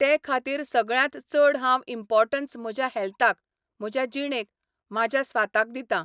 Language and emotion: Goan Konkani, neutral